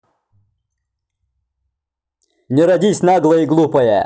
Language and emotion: Russian, angry